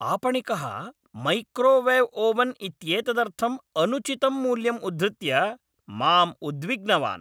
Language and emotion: Sanskrit, angry